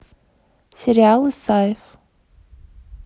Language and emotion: Russian, neutral